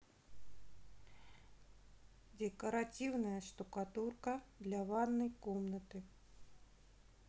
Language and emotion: Russian, neutral